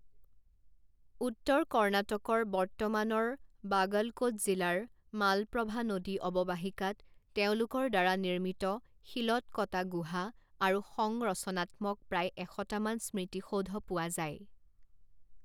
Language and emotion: Assamese, neutral